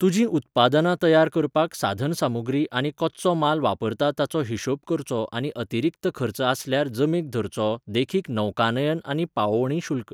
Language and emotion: Goan Konkani, neutral